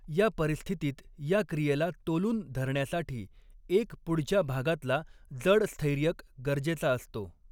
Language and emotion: Marathi, neutral